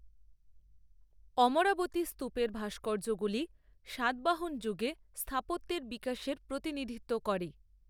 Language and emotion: Bengali, neutral